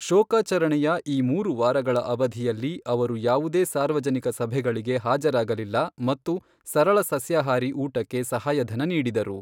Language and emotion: Kannada, neutral